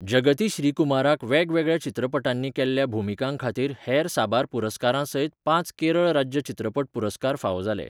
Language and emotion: Goan Konkani, neutral